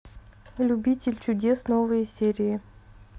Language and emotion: Russian, neutral